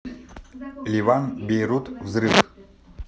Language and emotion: Russian, neutral